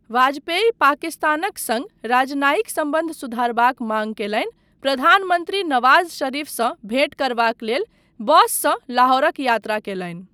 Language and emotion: Maithili, neutral